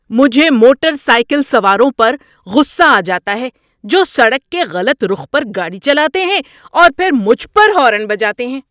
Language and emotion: Urdu, angry